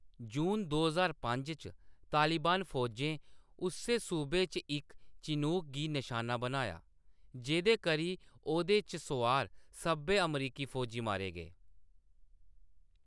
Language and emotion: Dogri, neutral